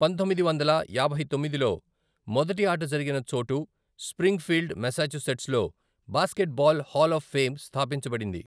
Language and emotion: Telugu, neutral